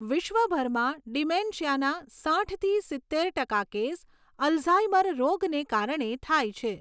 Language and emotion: Gujarati, neutral